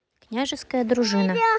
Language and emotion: Russian, neutral